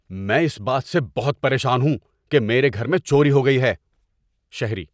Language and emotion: Urdu, angry